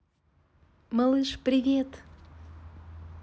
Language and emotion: Russian, positive